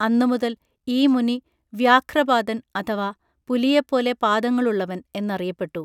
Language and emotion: Malayalam, neutral